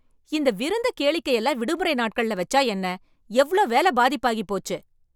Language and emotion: Tamil, angry